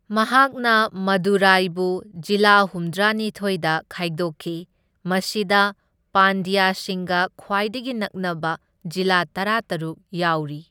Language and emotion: Manipuri, neutral